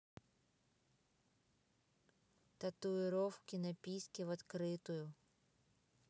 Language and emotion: Russian, neutral